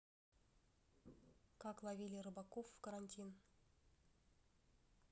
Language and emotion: Russian, neutral